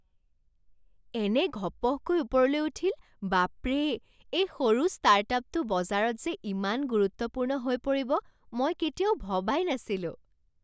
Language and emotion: Assamese, surprised